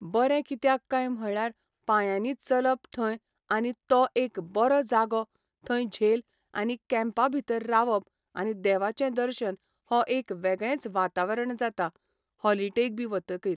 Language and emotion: Goan Konkani, neutral